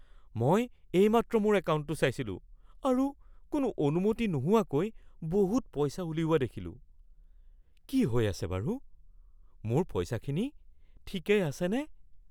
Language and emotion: Assamese, fearful